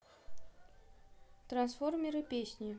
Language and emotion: Russian, neutral